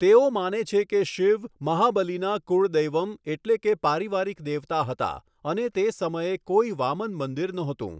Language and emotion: Gujarati, neutral